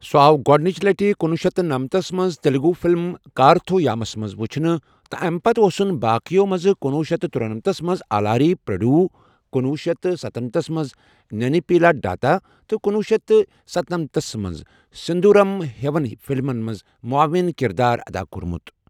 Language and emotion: Kashmiri, neutral